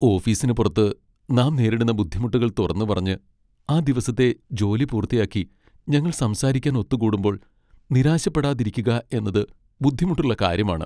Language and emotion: Malayalam, sad